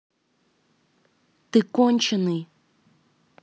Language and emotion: Russian, angry